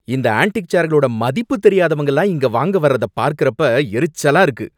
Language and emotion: Tamil, angry